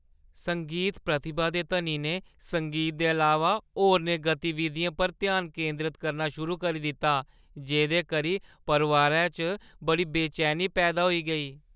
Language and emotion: Dogri, fearful